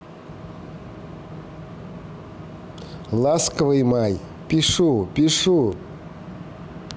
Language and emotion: Russian, positive